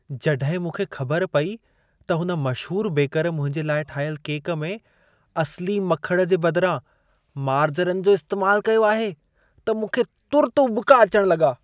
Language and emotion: Sindhi, disgusted